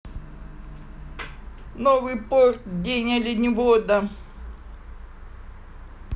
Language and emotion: Russian, positive